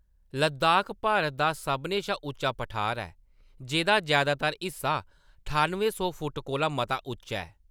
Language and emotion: Dogri, neutral